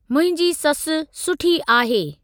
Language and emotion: Sindhi, neutral